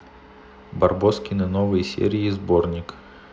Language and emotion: Russian, neutral